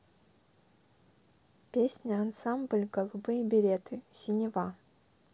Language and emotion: Russian, neutral